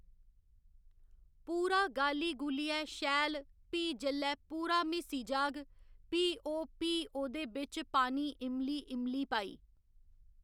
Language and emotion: Dogri, neutral